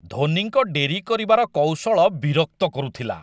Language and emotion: Odia, disgusted